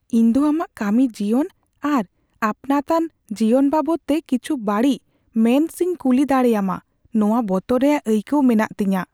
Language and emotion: Santali, fearful